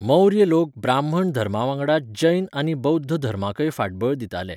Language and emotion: Goan Konkani, neutral